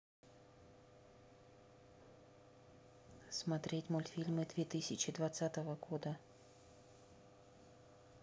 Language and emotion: Russian, neutral